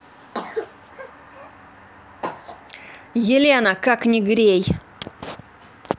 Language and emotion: Russian, angry